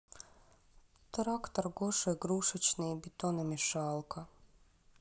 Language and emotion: Russian, sad